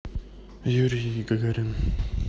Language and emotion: Russian, neutral